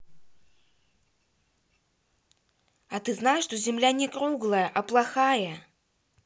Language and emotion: Russian, angry